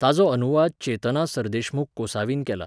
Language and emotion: Goan Konkani, neutral